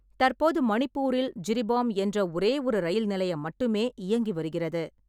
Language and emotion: Tamil, neutral